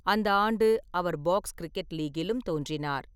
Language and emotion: Tamil, neutral